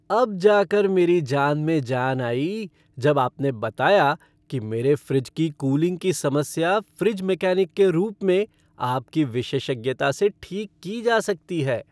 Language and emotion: Hindi, happy